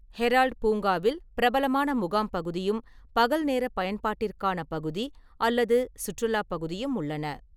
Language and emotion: Tamil, neutral